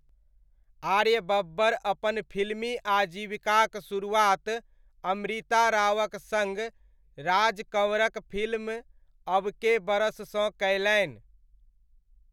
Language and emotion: Maithili, neutral